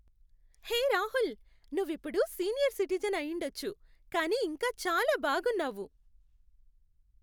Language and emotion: Telugu, happy